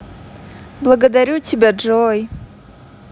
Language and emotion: Russian, positive